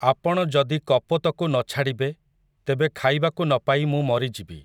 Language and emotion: Odia, neutral